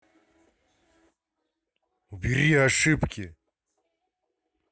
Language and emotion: Russian, angry